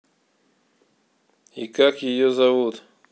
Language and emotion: Russian, neutral